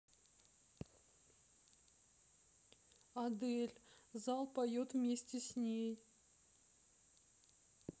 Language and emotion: Russian, sad